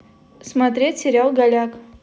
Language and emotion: Russian, neutral